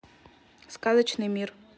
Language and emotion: Russian, neutral